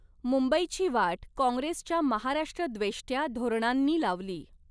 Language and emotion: Marathi, neutral